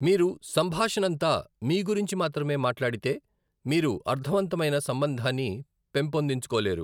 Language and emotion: Telugu, neutral